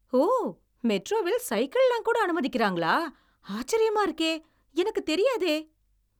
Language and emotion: Tamil, surprised